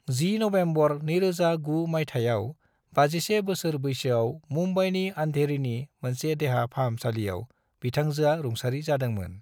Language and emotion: Bodo, neutral